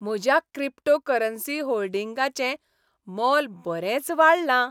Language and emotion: Goan Konkani, happy